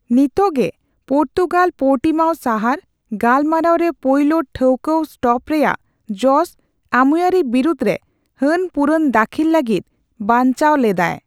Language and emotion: Santali, neutral